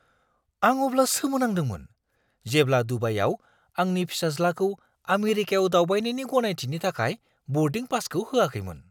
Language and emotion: Bodo, surprised